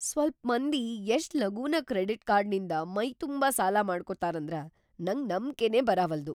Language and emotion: Kannada, surprised